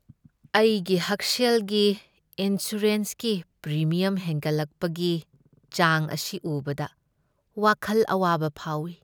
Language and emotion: Manipuri, sad